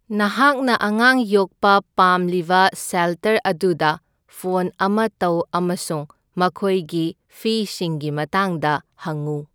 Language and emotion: Manipuri, neutral